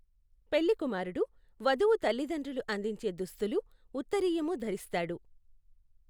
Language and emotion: Telugu, neutral